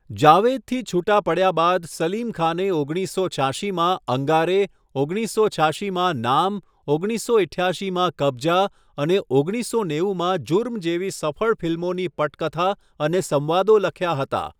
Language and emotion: Gujarati, neutral